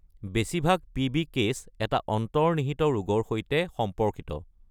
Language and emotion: Assamese, neutral